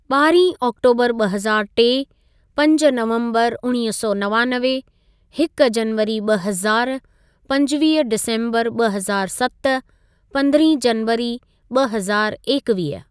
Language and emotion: Sindhi, neutral